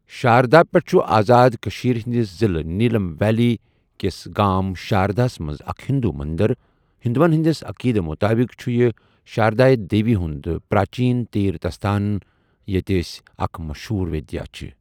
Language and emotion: Kashmiri, neutral